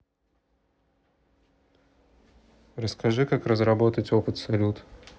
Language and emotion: Russian, neutral